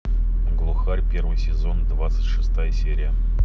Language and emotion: Russian, neutral